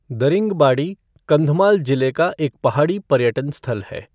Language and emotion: Hindi, neutral